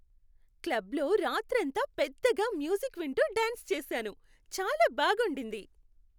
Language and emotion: Telugu, happy